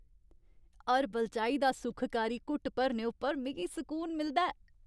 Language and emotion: Dogri, happy